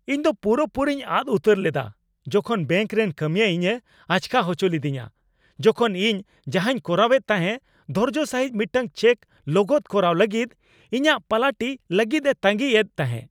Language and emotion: Santali, angry